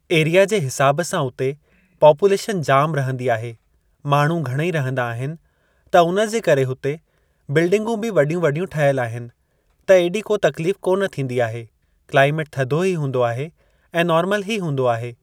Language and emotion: Sindhi, neutral